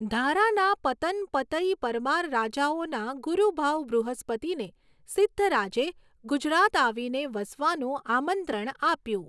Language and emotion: Gujarati, neutral